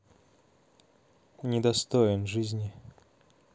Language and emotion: Russian, neutral